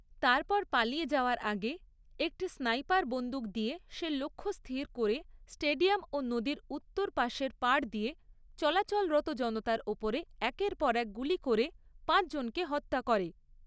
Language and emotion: Bengali, neutral